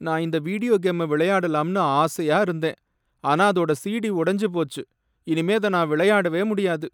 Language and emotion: Tamil, sad